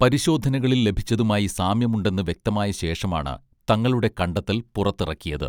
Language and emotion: Malayalam, neutral